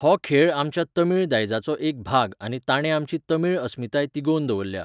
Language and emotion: Goan Konkani, neutral